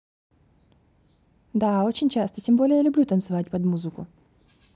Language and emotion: Russian, neutral